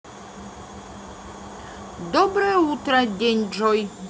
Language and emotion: Russian, positive